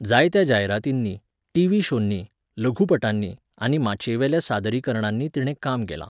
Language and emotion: Goan Konkani, neutral